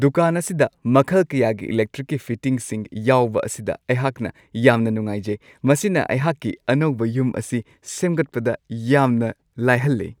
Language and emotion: Manipuri, happy